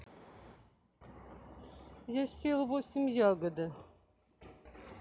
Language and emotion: Russian, neutral